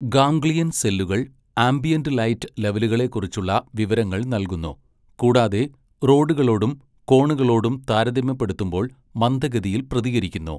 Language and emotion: Malayalam, neutral